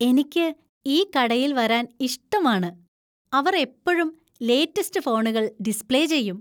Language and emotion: Malayalam, happy